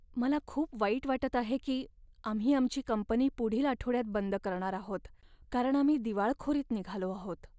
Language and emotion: Marathi, sad